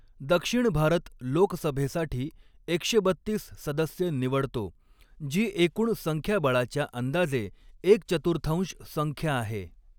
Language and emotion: Marathi, neutral